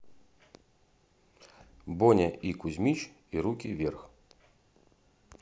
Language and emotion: Russian, neutral